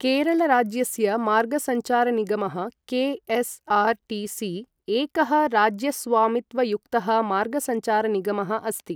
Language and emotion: Sanskrit, neutral